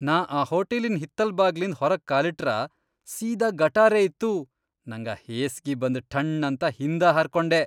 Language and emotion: Kannada, disgusted